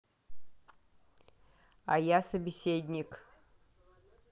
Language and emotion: Russian, neutral